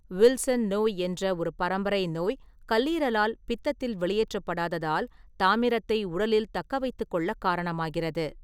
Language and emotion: Tamil, neutral